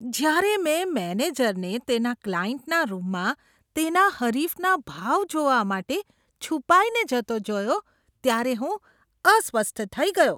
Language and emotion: Gujarati, disgusted